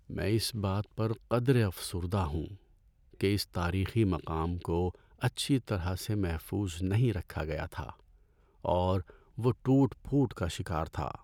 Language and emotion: Urdu, sad